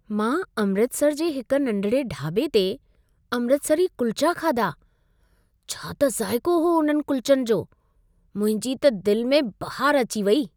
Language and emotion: Sindhi, happy